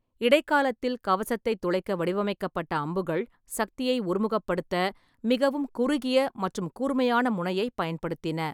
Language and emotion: Tamil, neutral